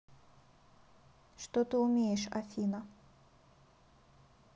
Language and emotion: Russian, neutral